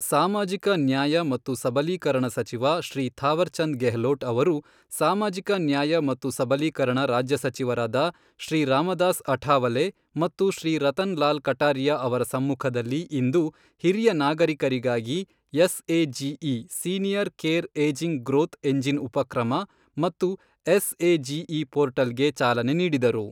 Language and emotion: Kannada, neutral